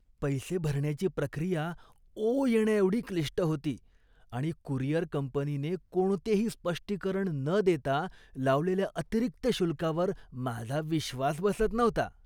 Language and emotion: Marathi, disgusted